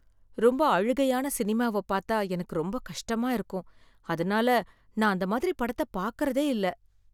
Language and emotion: Tamil, sad